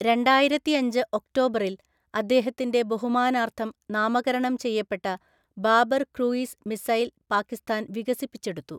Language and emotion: Malayalam, neutral